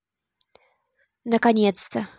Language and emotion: Russian, neutral